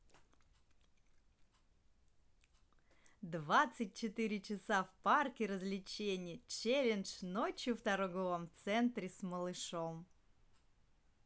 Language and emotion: Russian, positive